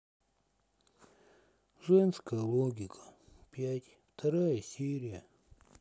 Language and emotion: Russian, sad